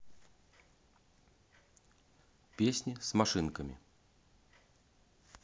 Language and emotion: Russian, neutral